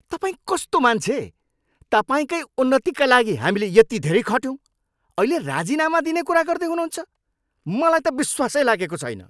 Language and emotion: Nepali, angry